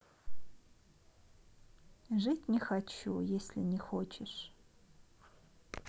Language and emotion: Russian, sad